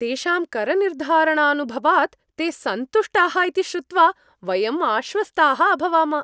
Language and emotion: Sanskrit, happy